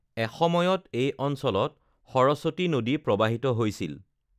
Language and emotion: Assamese, neutral